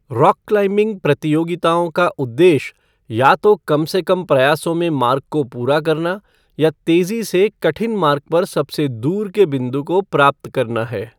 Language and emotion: Hindi, neutral